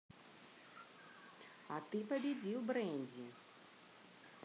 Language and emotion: Russian, neutral